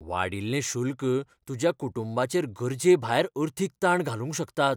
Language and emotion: Goan Konkani, fearful